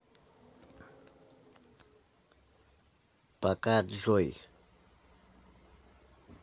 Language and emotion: Russian, neutral